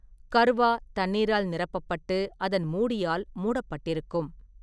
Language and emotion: Tamil, neutral